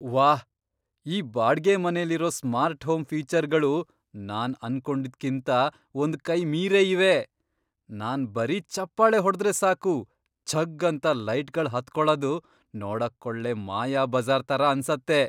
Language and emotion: Kannada, surprised